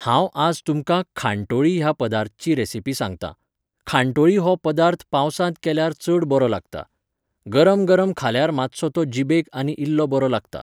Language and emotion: Goan Konkani, neutral